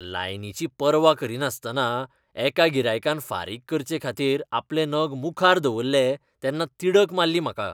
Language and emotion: Goan Konkani, disgusted